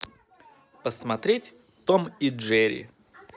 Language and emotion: Russian, positive